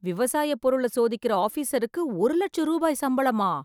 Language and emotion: Tamil, surprised